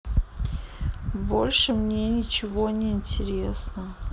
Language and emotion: Russian, sad